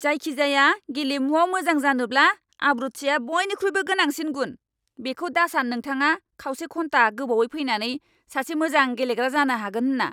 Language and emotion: Bodo, angry